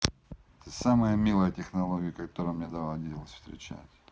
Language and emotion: Russian, neutral